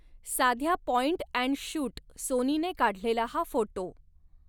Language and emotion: Marathi, neutral